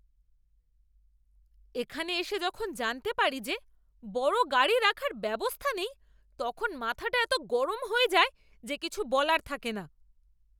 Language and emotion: Bengali, angry